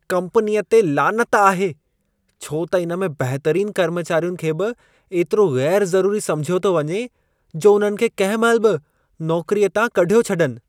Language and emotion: Sindhi, disgusted